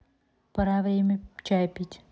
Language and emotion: Russian, neutral